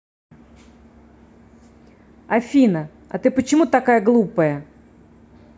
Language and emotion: Russian, angry